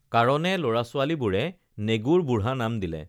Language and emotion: Assamese, neutral